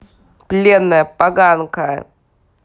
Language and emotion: Russian, angry